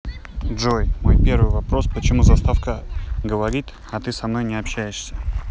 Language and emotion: Russian, neutral